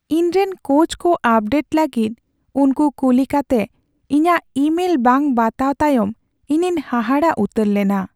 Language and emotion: Santali, sad